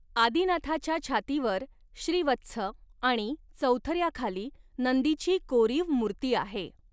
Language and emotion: Marathi, neutral